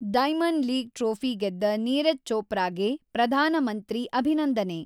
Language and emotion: Kannada, neutral